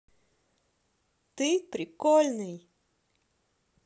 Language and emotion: Russian, positive